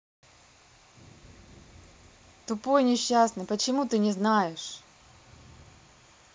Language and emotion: Russian, neutral